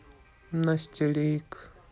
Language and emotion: Russian, neutral